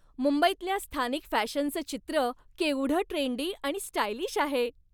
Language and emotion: Marathi, happy